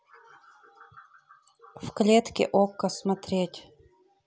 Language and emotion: Russian, neutral